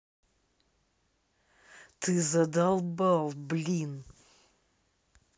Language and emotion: Russian, angry